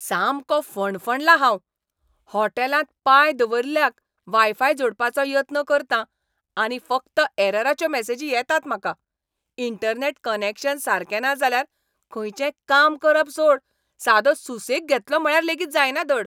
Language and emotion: Goan Konkani, angry